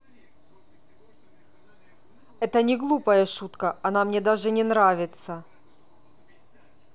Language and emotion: Russian, angry